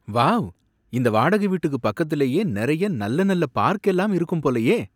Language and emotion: Tamil, surprised